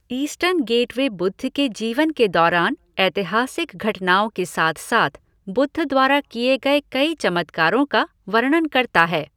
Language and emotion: Hindi, neutral